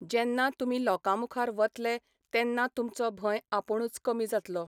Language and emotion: Goan Konkani, neutral